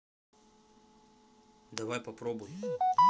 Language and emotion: Russian, neutral